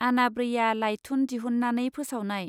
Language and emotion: Bodo, neutral